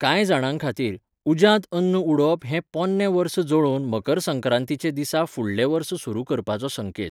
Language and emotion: Goan Konkani, neutral